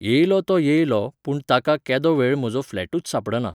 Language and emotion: Goan Konkani, neutral